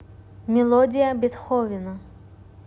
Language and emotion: Russian, neutral